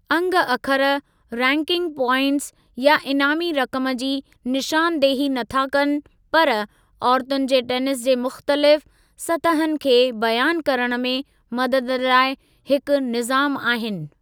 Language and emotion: Sindhi, neutral